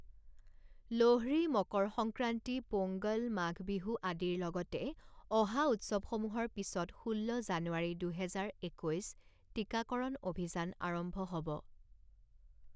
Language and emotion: Assamese, neutral